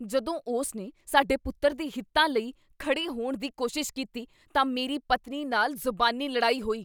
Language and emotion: Punjabi, angry